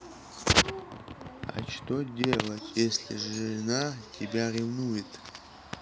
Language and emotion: Russian, neutral